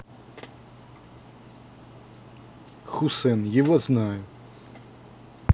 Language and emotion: Russian, neutral